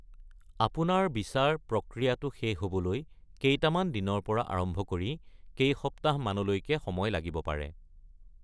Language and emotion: Assamese, neutral